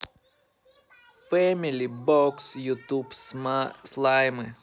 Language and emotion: Russian, positive